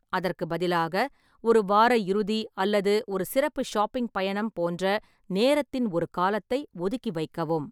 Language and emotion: Tamil, neutral